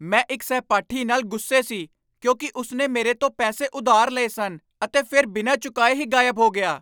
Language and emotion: Punjabi, angry